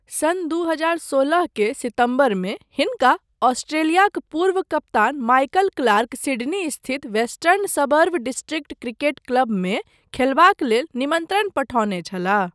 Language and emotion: Maithili, neutral